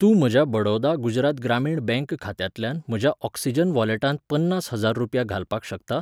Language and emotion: Goan Konkani, neutral